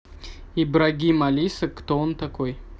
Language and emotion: Russian, neutral